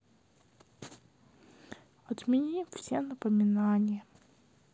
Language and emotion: Russian, sad